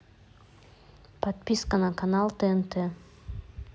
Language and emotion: Russian, neutral